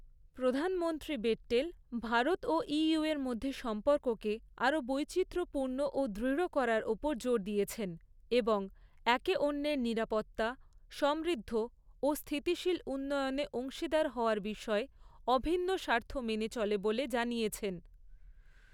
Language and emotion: Bengali, neutral